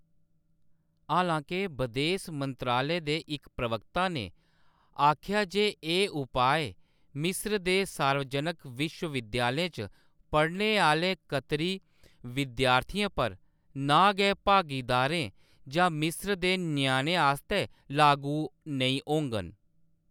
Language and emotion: Dogri, neutral